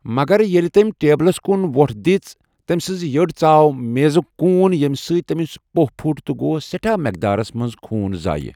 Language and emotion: Kashmiri, neutral